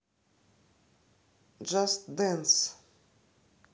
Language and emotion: Russian, neutral